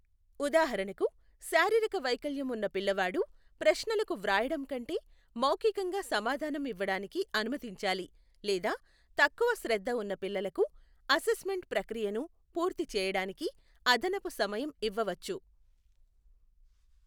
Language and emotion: Telugu, neutral